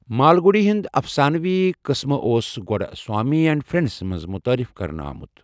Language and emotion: Kashmiri, neutral